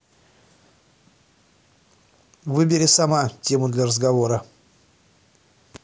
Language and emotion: Russian, angry